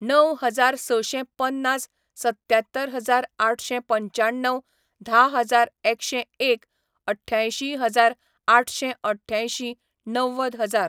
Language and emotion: Goan Konkani, neutral